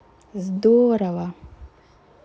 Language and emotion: Russian, positive